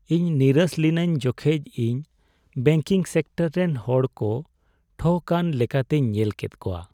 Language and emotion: Santali, sad